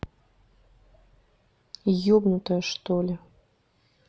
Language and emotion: Russian, neutral